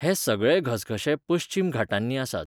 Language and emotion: Goan Konkani, neutral